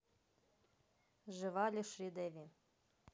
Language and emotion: Russian, neutral